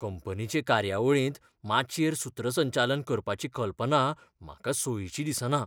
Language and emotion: Goan Konkani, fearful